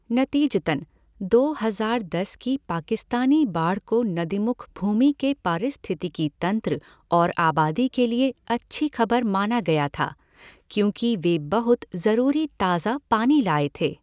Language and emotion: Hindi, neutral